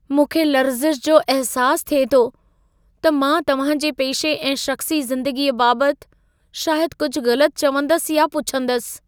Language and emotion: Sindhi, fearful